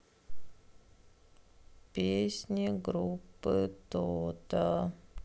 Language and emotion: Russian, sad